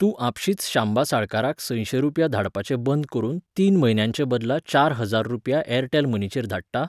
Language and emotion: Goan Konkani, neutral